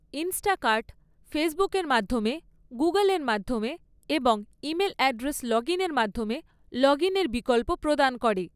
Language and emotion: Bengali, neutral